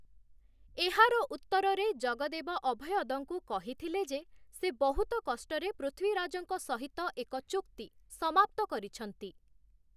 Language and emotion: Odia, neutral